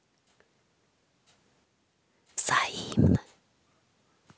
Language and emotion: Russian, neutral